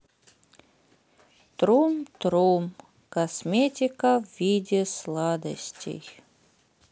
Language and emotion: Russian, sad